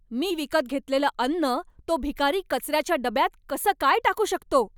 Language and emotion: Marathi, angry